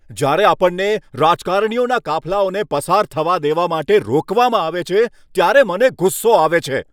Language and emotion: Gujarati, angry